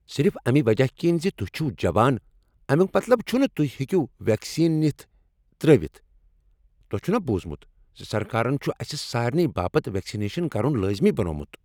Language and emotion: Kashmiri, angry